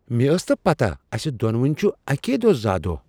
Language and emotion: Kashmiri, surprised